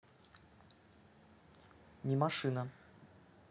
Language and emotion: Russian, neutral